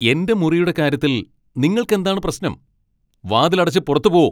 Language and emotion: Malayalam, angry